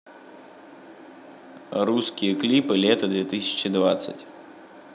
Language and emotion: Russian, neutral